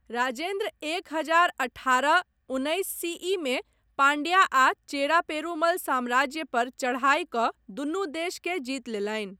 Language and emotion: Maithili, neutral